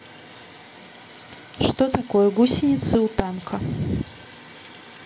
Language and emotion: Russian, neutral